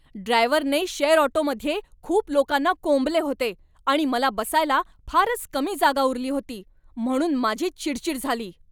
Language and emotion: Marathi, angry